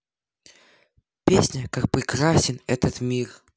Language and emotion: Russian, positive